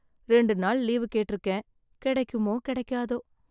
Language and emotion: Tamil, sad